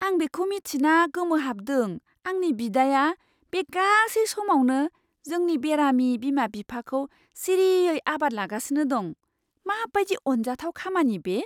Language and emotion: Bodo, surprised